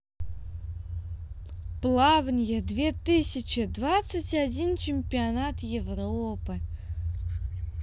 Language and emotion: Russian, positive